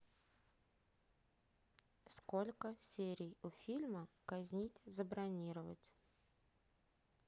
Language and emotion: Russian, neutral